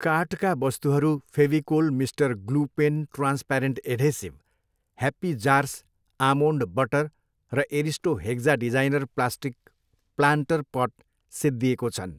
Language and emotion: Nepali, neutral